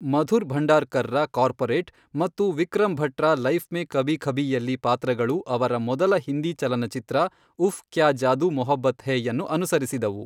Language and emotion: Kannada, neutral